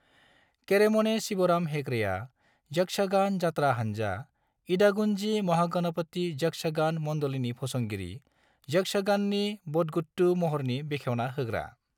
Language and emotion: Bodo, neutral